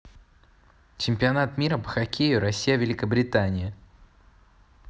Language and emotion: Russian, neutral